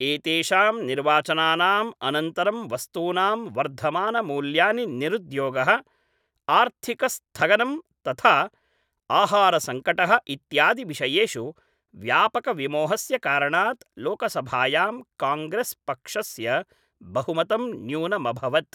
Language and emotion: Sanskrit, neutral